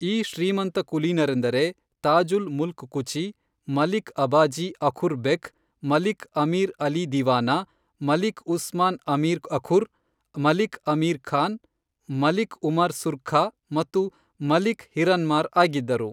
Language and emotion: Kannada, neutral